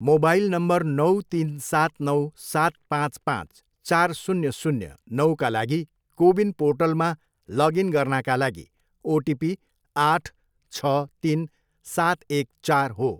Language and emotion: Nepali, neutral